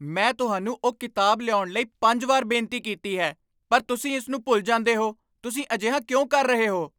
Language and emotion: Punjabi, angry